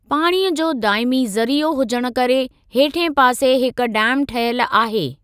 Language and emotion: Sindhi, neutral